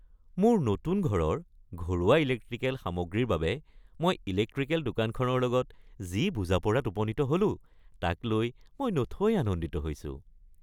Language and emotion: Assamese, happy